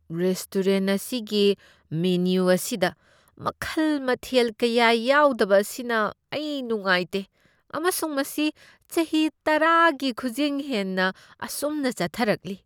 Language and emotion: Manipuri, disgusted